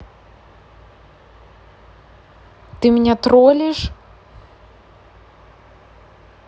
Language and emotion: Russian, neutral